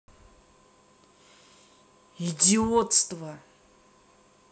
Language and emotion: Russian, angry